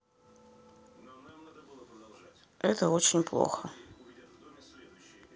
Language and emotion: Russian, sad